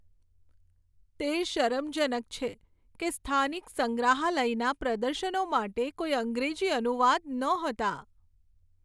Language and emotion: Gujarati, sad